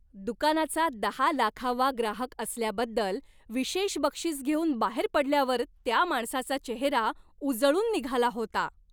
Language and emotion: Marathi, happy